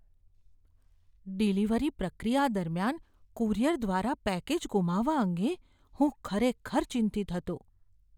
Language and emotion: Gujarati, fearful